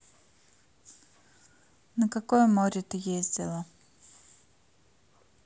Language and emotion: Russian, neutral